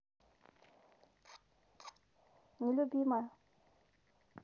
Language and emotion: Russian, neutral